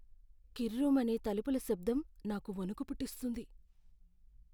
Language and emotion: Telugu, fearful